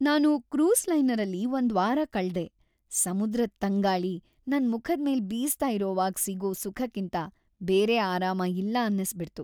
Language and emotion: Kannada, happy